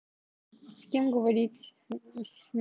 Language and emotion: Russian, neutral